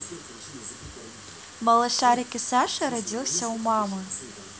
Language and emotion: Russian, positive